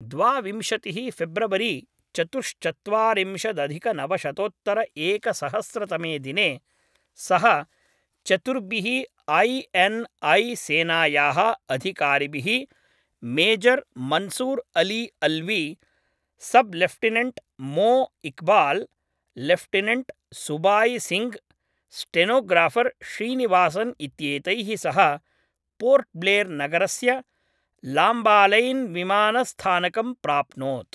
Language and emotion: Sanskrit, neutral